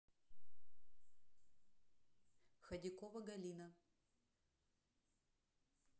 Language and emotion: Russian, neutral